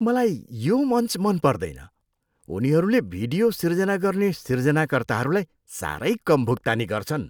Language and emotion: Nepali, disgusted